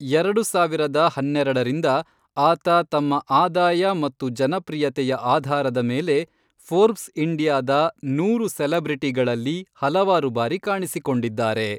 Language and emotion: Kannada, neutral